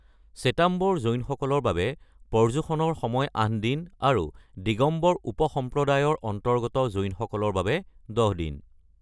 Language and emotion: Assamese, neutral